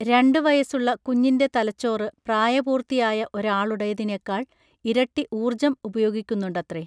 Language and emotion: Malayalam, neutral